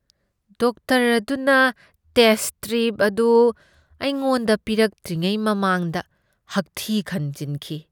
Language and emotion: Manipuri, disgusted